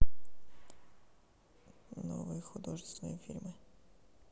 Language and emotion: Russian, neutral